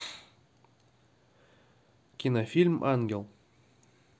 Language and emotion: Russian, neutral